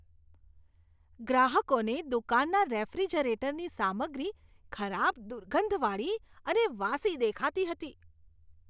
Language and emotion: Gujarati, disgusted